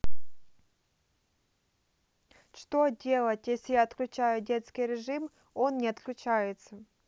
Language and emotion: Russian, neutral